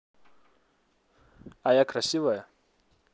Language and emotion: Russian, neutral